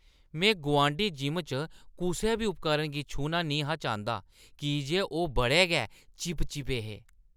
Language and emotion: Dogri, disgusted